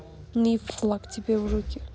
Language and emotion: Russian, angry